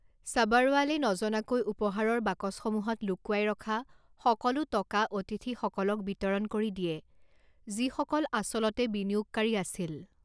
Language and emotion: Assamese, neutral